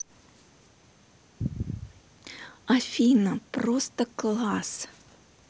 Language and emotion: Russian, positive